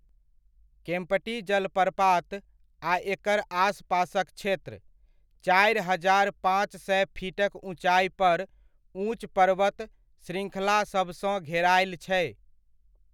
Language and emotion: Maithili, neutral